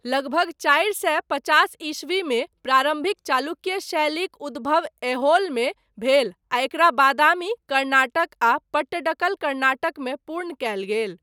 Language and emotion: Maithili, neutral